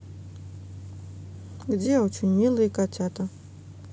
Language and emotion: Russian, neutral